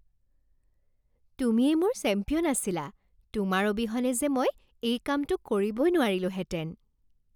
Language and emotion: Assamese, happy